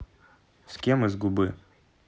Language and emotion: Russian, neutral